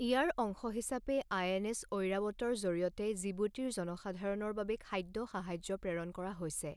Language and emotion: Assamese, neutral